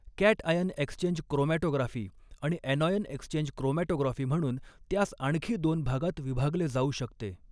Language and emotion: Marathi, neutral